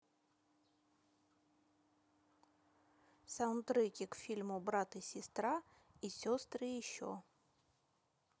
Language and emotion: Russian, neutral